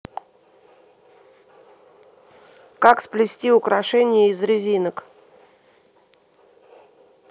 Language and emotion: Russian, neutral